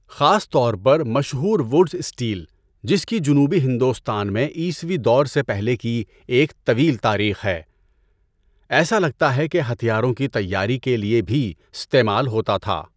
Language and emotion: Urdu, neutral